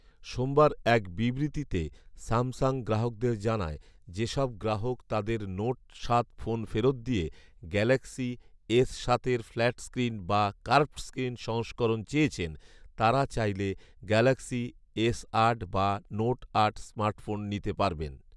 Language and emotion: Bengali, neutral